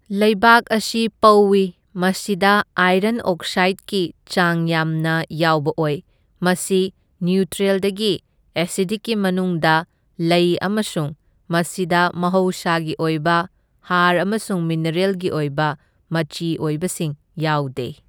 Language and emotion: Manipuri, neutral